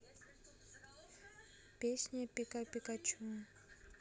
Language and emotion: Russian, neutral